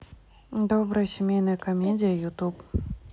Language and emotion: Russian, neutral